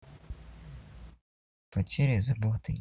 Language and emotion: Russian, sad